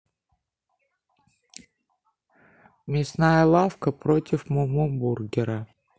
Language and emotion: Russian, neutral